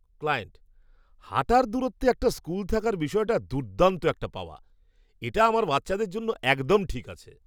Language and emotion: Bengali, surprised